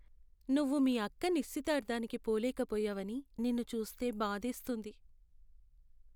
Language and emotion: Telugu, sad